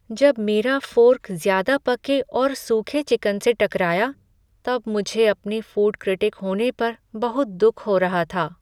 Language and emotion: Hindi, sad